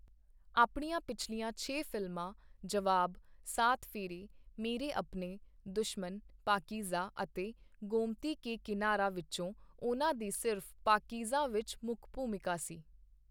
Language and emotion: Punjabi, neutral